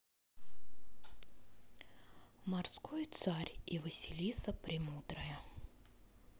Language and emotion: Russian, neutral